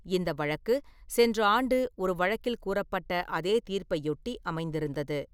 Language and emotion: Tamil, neutral